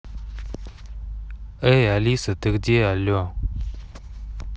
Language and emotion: Russian, neutral